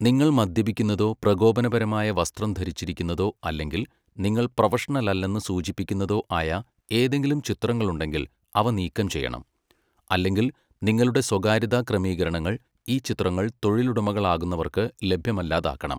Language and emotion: Malayalam, neutral